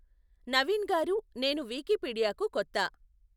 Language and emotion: Telugu, neutral